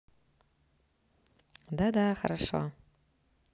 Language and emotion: Russian, neutral